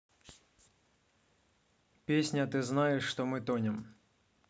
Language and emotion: Russian, neutral